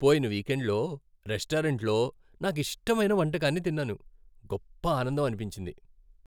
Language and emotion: Telugu, happy